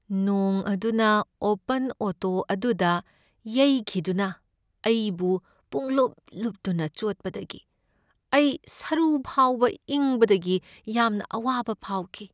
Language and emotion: Manipuri, sad